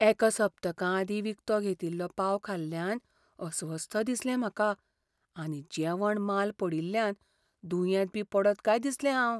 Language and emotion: Goan Konkani, fearful